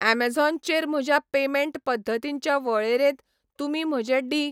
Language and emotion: Goan Konkani, neutral